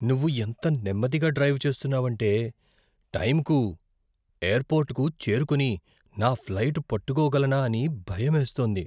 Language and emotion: Telugu, fearful